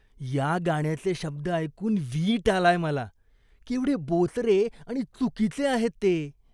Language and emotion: Marathi, disgusted